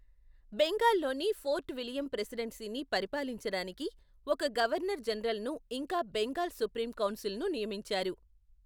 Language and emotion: Telugu, neutral